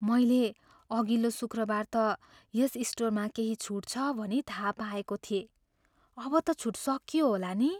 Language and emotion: Nepali, fearful